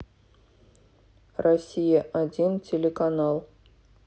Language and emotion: Russian, neutral